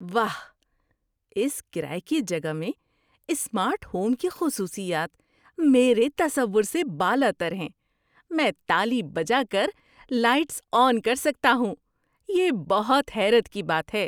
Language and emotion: Urdu, surprised